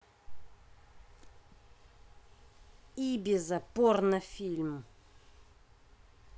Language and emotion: Russian, angry